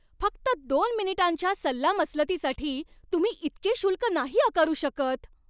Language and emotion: Marathi, angry